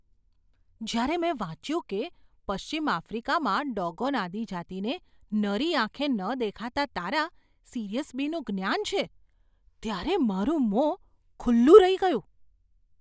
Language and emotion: Gujarati, surprised